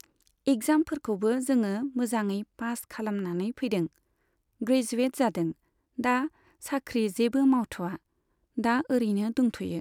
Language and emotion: Bodo, neutral